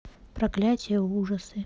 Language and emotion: Russian, neutral